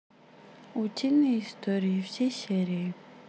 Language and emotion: Russian, neutral